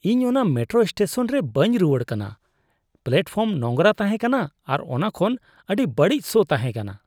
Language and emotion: Santali, disgusted